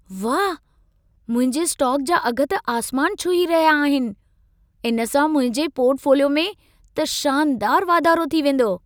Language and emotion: Sindhi, happy